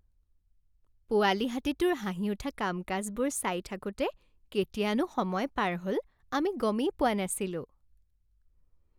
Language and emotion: Assamese, happy